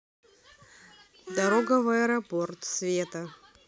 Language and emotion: Russian, neutral